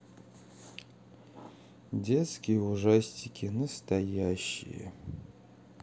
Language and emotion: Russian, sad